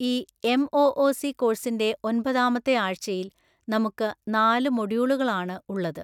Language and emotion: Malayalam, neutral